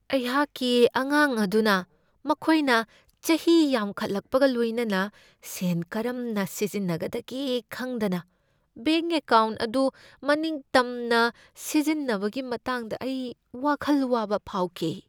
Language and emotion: Manipuri, fearful